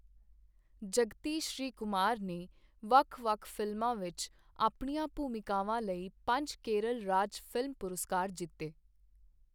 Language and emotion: Punjabi, neutral